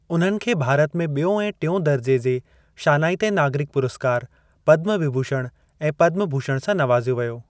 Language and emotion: Sindhi, neutral